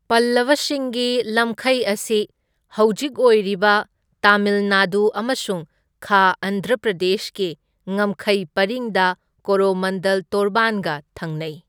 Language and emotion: Manipuri, neutral